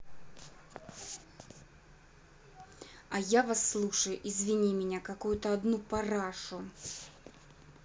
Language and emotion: Russian, angry